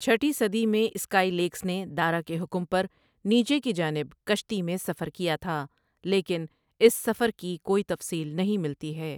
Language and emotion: Urdu, neutral